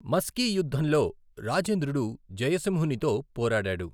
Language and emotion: Telugu, neutral